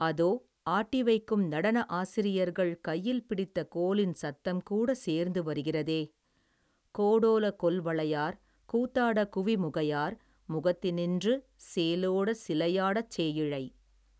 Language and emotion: Tamil, neutral